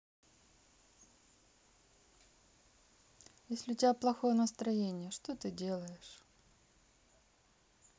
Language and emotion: Russian, sad